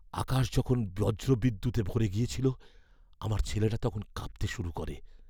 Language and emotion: Bengali, fearful